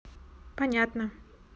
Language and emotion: Russian, neutral